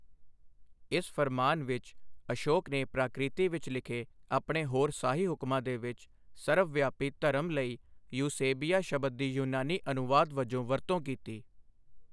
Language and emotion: Punjabi, neutral